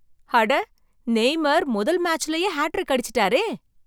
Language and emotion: Tamil, surprised